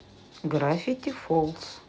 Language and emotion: Russian, neutral